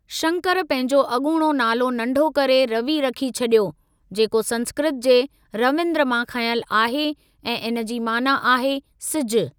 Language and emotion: Sindhi, neutral